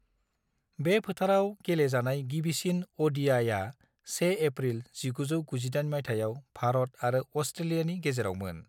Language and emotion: Bodo, neutral